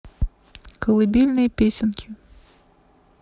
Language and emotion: Russian, neutral